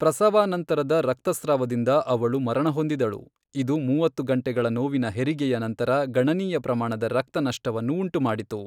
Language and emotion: Kannada, neutral